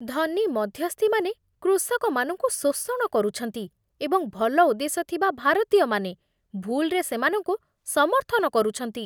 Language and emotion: Odia, disgusted